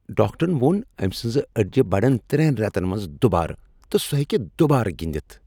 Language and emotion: Kashmiri, happy